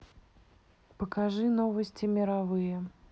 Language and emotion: Russian, neutral